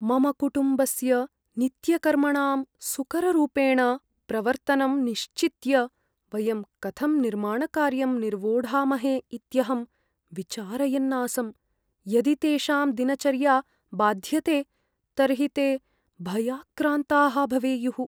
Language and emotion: Sanskrit, fearful